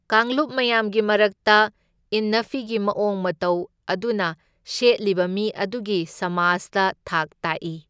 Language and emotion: Manipuri, neutral